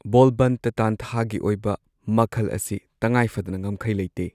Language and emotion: Manipuri, neutral